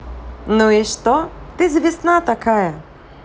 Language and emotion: Russian, positive